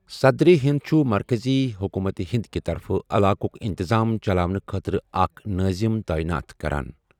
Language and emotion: Kashmiri, neutral